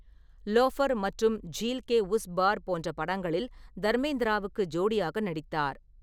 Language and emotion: Tamil, neutral